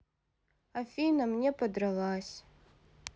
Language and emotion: Russian, sad